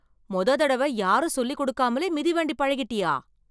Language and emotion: Tamil, surprised